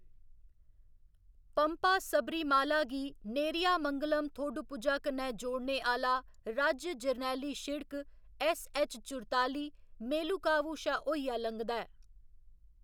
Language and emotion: Dogri, neutral